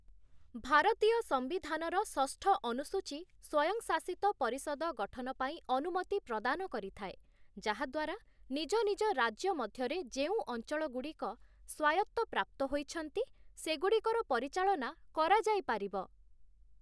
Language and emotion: Odia, neutral